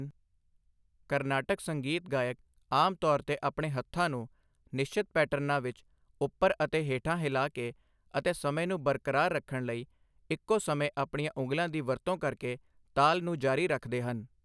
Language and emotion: Punjabi, neutral